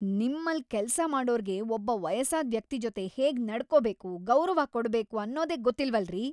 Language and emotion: Kannada, angry